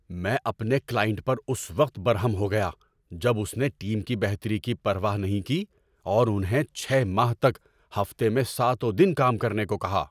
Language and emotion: Urdu, angry